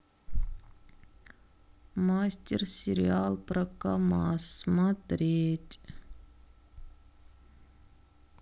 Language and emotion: Russian, sad